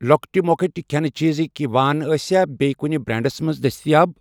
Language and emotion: Kashmiri, neutral